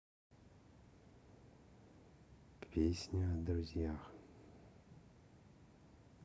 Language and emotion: Russian, neutral